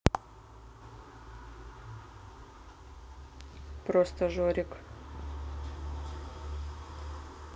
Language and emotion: Russian, neutral